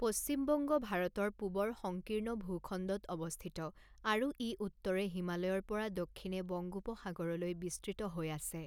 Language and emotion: Assamese, neutral